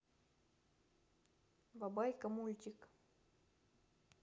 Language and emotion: Russian, neutral